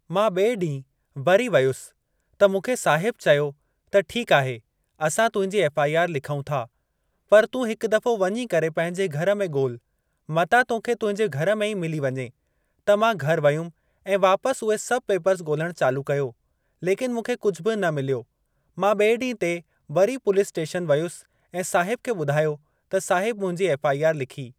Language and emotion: Sindhi, neutral